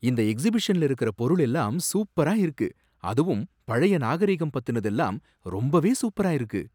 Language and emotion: Tamil, surprised